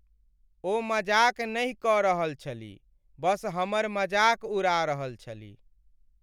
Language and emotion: Maithili, sad